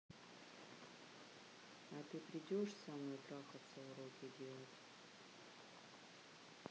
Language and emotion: Russian, neutral